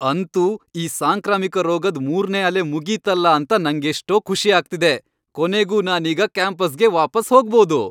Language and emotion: Kannada, happy